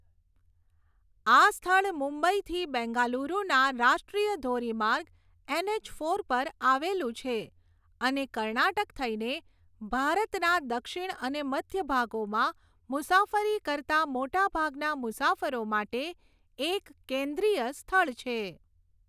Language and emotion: Gujarati, neutral